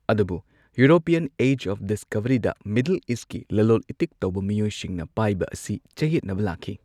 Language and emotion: Manipuri, neutral